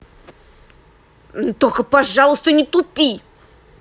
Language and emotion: Russian, angry